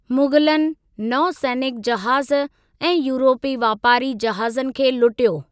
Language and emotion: Sindhi, neutral